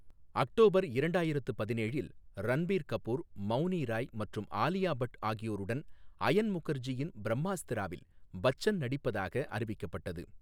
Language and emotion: Tamil, neutral